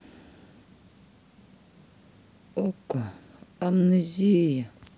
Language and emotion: Russian, neutral